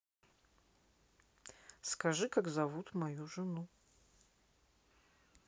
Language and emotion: Russian, neutral